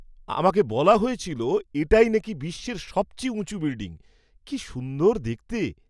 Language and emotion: Bengali, surprised